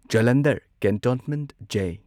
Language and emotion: Manipuri, neutral